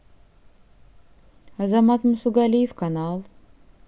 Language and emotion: Russian, neutral